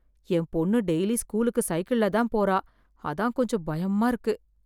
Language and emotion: Tamil, fearful